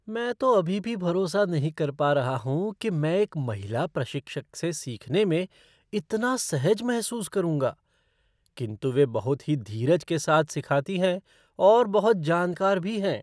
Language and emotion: Hindi, surprised